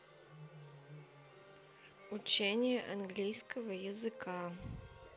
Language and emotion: Russian, neutral